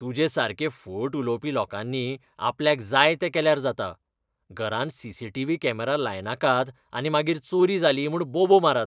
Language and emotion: Goan Konkani, disgusted